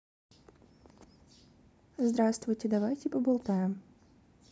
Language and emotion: Russian, neutral